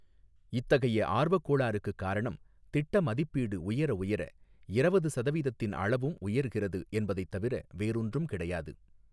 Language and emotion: Tamil, neutral